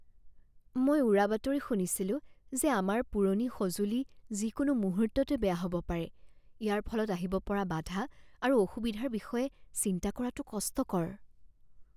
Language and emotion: Assamese, fearful